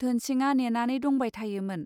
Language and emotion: Bodo, neutral